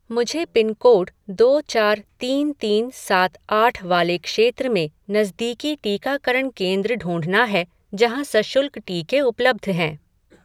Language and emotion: Hindi, neutral